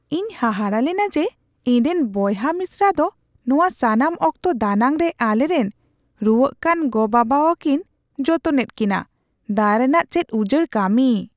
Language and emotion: Santali, surprised